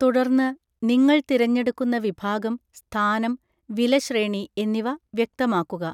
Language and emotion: Malayalam, neutral